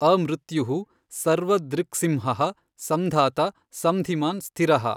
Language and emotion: Kannada, neutral